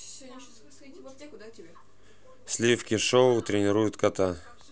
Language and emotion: Russian, neutral